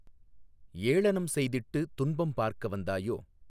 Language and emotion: Tamil, neutral